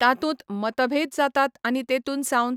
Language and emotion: Goan Konkani, neutral